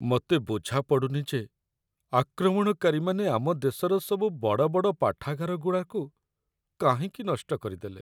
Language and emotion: Odia, sad